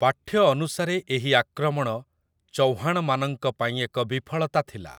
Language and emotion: Odia, neutral